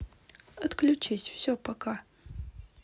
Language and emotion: Russian, neutral